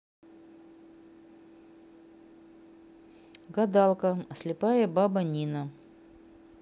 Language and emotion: Russian, neutral